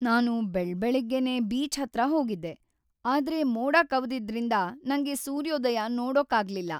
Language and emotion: Kannada, sad